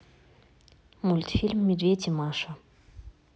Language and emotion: Russian, neutral